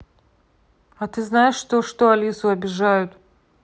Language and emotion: Russian, angry